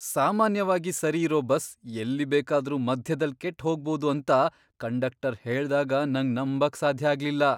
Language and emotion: Kannada, surprised